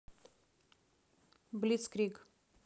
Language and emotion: Russian, neutral